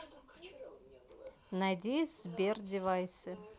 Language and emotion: Russian, neutral